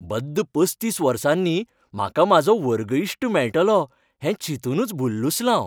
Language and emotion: Goan Konkani, happy